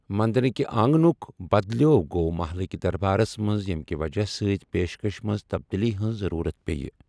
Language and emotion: Kashmiri, neutral